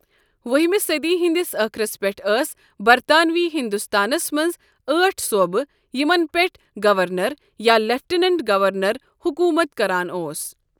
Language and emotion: Kashmiri, neutral